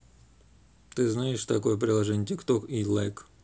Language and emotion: Russian, neutral